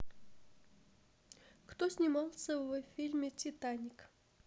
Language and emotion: Russian, neutral